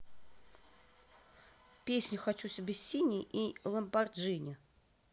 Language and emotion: Russian, neutral